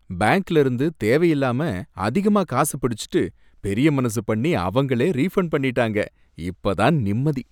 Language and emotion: Tamil, happy